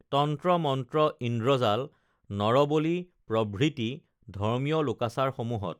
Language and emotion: Assamese, neutral